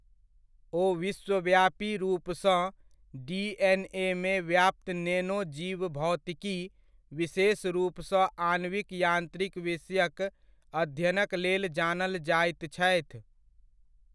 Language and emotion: Maithili, neutral